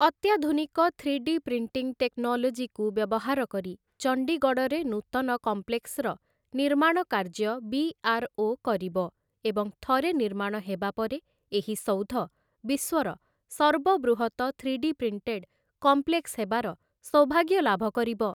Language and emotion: Odia, neutral